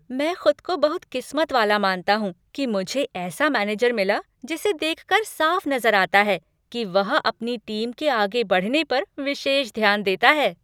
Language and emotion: Hindi, happy